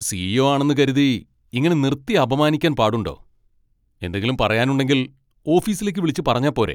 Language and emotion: Malayalam, angry